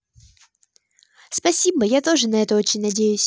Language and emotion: Russian, positive